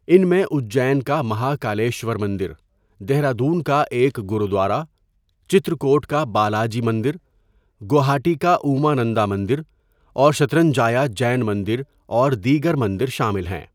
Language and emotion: Urdu, neutral